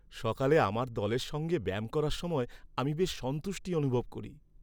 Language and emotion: Bengali, happy